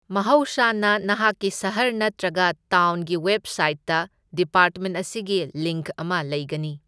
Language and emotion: Manipuri, neutral